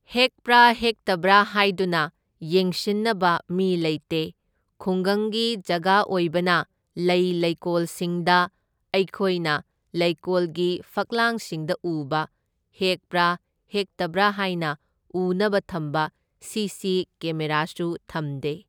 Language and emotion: Manipuri, neutral